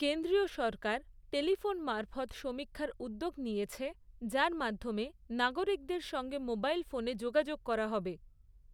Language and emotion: Bengali, neutral